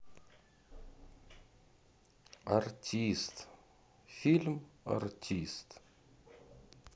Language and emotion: Russian, sad